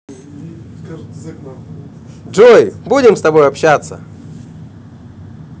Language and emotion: Russian, positive